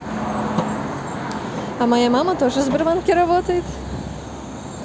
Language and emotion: Russian, positive